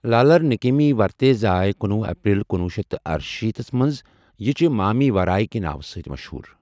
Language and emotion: Kashmiri, neutral